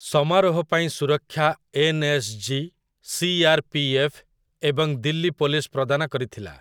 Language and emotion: Odia, neutral